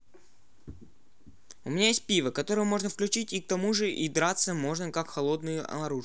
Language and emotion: Russian, neutral